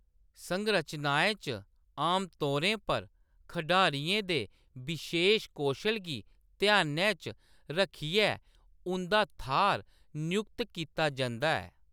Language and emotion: Dogri, neutral